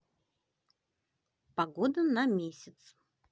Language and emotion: Russian, positive